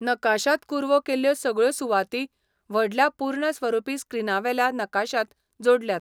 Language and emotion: Goan Konkani, neutral